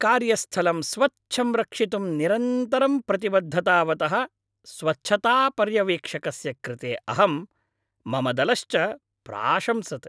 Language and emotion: Sanskrit, happy